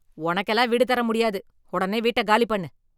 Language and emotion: Tamil, angry